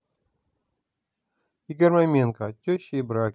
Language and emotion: Russian, neutral